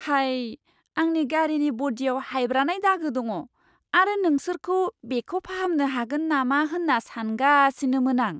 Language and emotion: Bodo, surprised